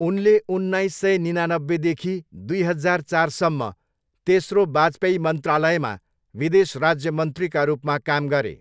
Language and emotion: Nepali, neutral